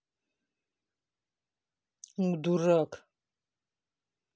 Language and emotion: Russian, angry